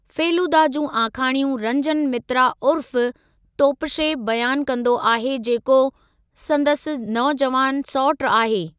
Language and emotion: Sindhi, neutral